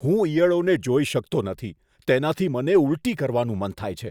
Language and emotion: Gujarati, disgusted